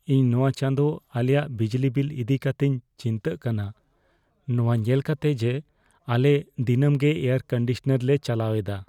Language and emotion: Santali, fearful